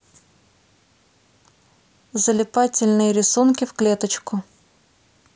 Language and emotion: Russian, neutral